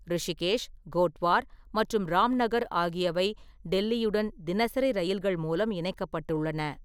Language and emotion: Tamil, neutral